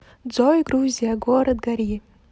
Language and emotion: Russian, neutral